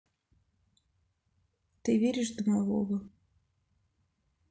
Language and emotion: Russian, sad